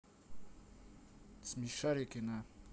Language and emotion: Russian, neutral